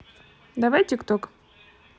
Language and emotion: Russian, neutral